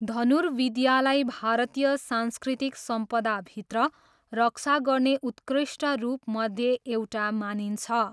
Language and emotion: Nepali, neutral